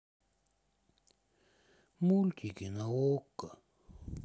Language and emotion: Russian, sad